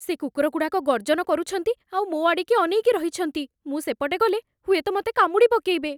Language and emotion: Odia, fearful